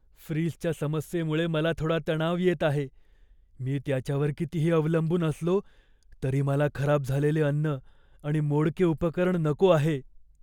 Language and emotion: Marathi, fearful